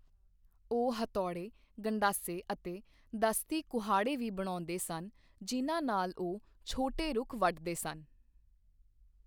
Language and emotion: Punjabi, neutral